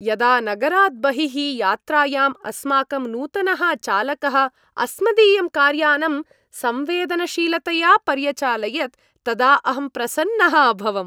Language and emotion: Sanskrit, happy